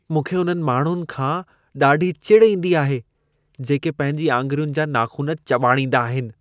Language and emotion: Sindhi, disgusted